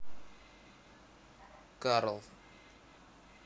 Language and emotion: Russian, neutral